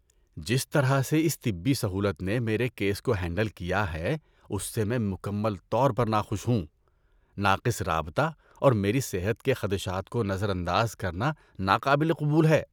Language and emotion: Urdu, disgusted